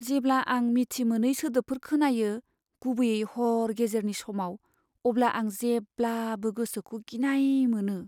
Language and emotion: Bodo, fearful